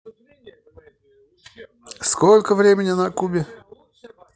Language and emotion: Russian, neutral